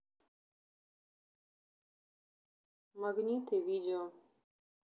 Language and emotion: Russian, neutral